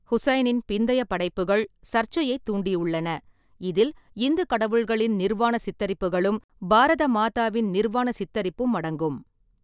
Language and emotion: Tamil, neutral